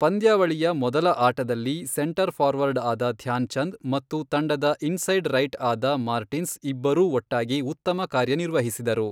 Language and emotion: Kannada, neutral